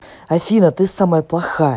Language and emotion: Russian, angry